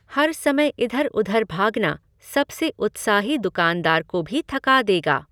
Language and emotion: Hindi, neutral